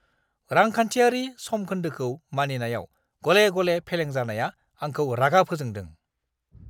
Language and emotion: Bodo, angry